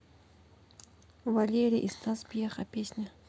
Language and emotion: Russian, neutral